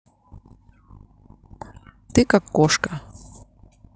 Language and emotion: Russian, neutral